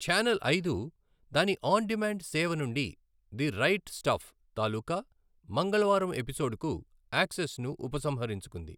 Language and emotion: Telugu, neutral